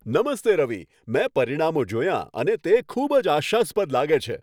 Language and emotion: Gujarati, happy